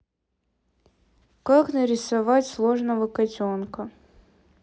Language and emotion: Russian, neutral